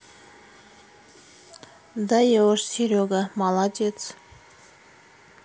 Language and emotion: Russian, neutral